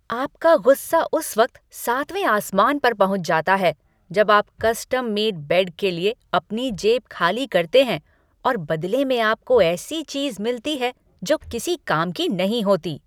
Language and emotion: Hindi, angry